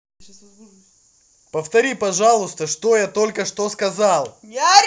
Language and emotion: Russian, angry